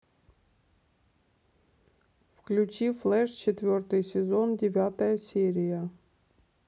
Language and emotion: Russian, neutral